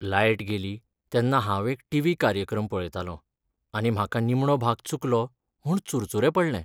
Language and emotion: Goan Konkani, sad